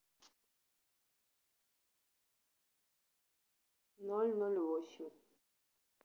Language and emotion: Russian, neutral